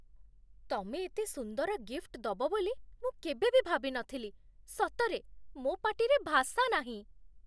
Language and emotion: Odia, surprised